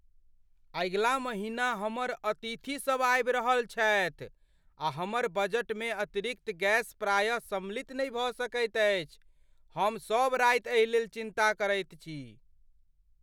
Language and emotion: Maithili, fearful